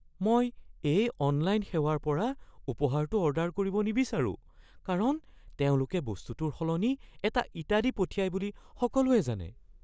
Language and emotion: Assamese, fearful